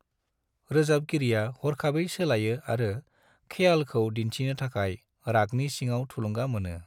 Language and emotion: Bodo, neutral